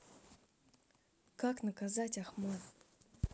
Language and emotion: Russian, neutral